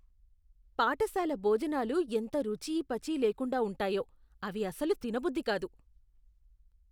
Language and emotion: Telugu, disgusted